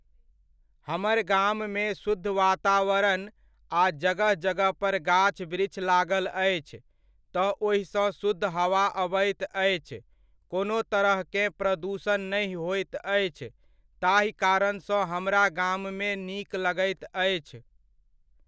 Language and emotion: Maithili, neutral